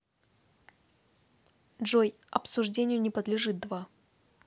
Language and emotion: Russian, neutral